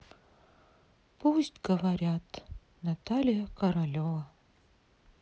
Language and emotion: Russian, sad